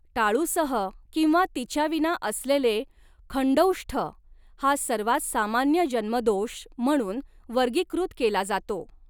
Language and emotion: Marathi, neutral